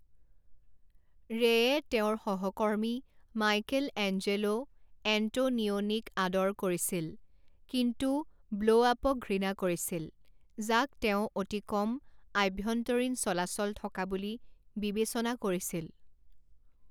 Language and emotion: Assamese, neutral